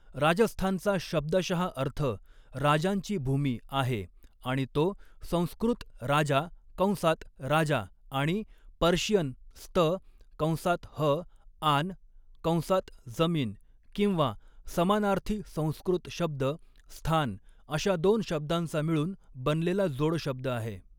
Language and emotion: Marathi, neutral